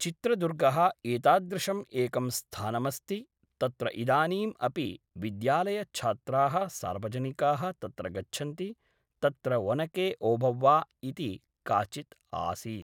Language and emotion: Sanskrit, neutral